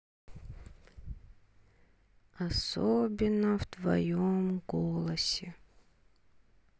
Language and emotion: Russian, sad